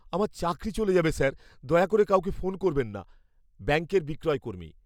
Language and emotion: Bengali, fearful